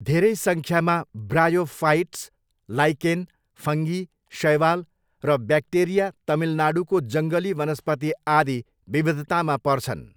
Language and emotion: Nepali, neutral